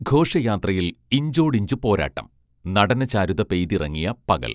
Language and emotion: Malayalam, neutral